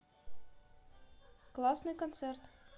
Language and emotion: Russian, positive